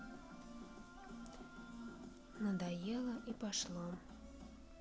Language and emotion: Russian, sad